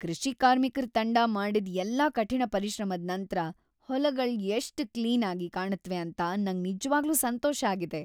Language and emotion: Kannada, happy